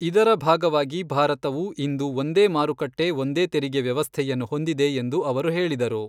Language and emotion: Kannada, neutral